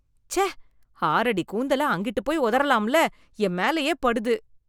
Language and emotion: Tamil, disgusted